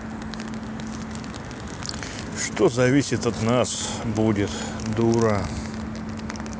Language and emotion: Russian, sad